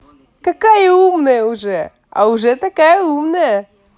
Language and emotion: Russian, positive